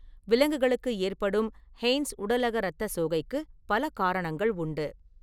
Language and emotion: Tamil, neutral